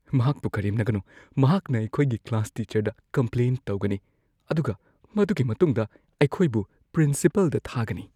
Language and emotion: Manipuri, fearful